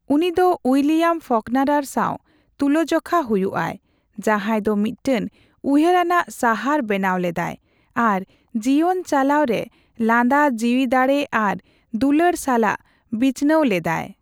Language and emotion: Santali, neutral